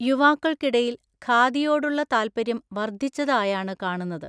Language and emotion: Malayalam, neutral